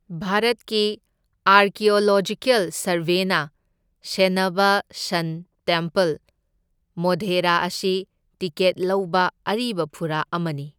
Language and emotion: Manipuri, neutral